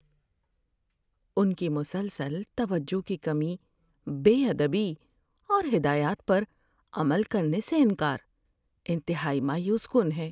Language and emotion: Urdu, sad